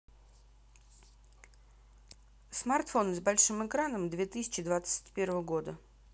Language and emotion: Russian, neutral